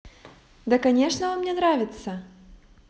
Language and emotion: Russian, positive